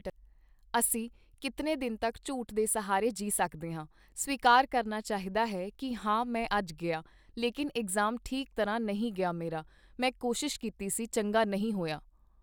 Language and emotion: Punjabi, neutral